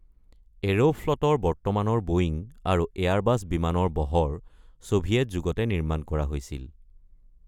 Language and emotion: Assamese, neutral